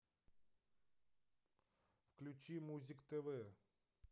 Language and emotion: Russian, neutral